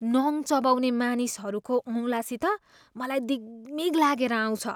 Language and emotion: Nepali, disgusted